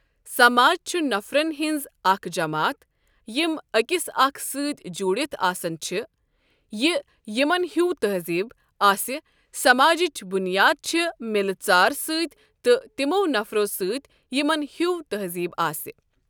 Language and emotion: Kashmiri, neutral